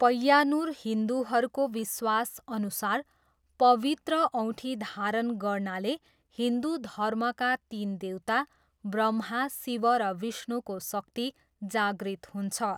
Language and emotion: Nepali, neutral